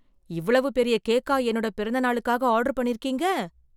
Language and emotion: Tamil, surprised